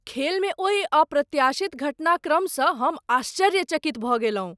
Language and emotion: Maithili, surprised